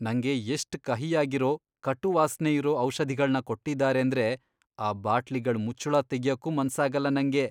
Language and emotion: Kannada, disgusted